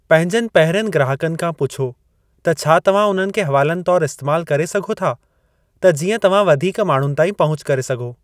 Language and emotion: Sindhi, neutral